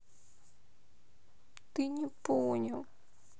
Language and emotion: Russian, sad